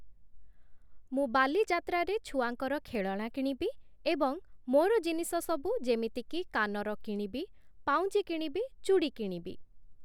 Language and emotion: Odia, neutral